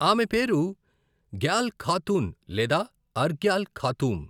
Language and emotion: Telugu, neutral